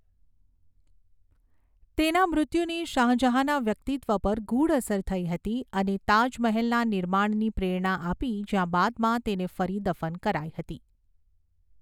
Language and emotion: Gujarati, neutral